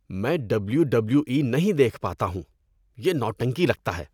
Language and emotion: Urdu, disgusted